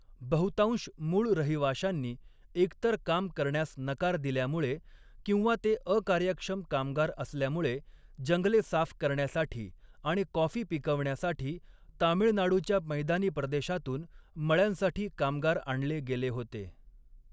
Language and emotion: Marathi, neutral